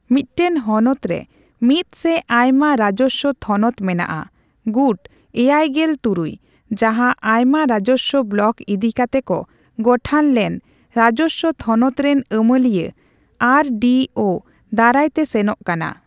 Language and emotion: Santali, neutral